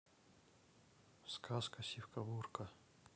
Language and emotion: Russian, neutral